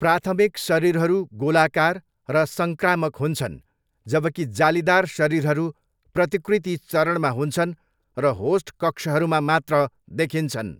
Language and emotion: Nepali, neutral